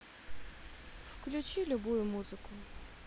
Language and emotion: Russian, neutral